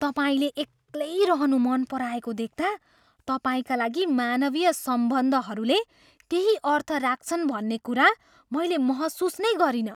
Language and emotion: Nepali, surprised